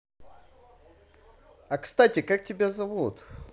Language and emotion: Russian, positive